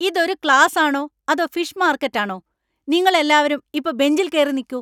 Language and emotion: Malayalam, angry